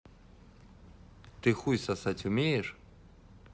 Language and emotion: Russian, neutral